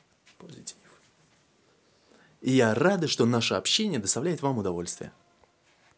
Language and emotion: Russian, positive